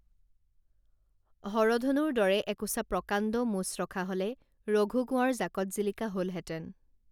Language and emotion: Assamese, neutral